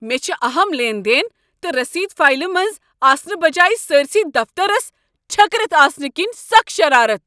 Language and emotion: Kashmiri, angry